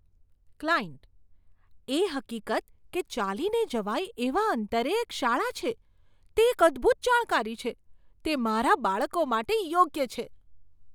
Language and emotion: Gujarati, surprised